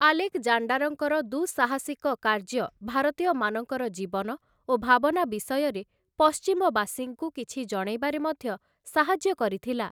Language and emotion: Odia, neutral